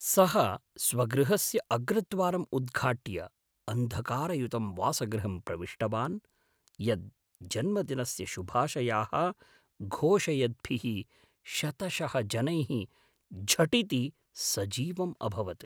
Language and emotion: Sanskrit, surprised